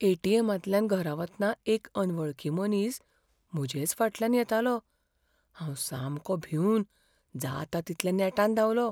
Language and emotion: Goan Konkani, fearful